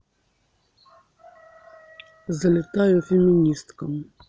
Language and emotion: Russian, neutral